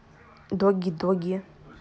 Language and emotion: Russian, neutral